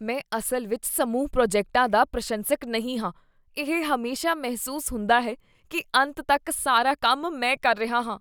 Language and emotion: Punjabi, disgusted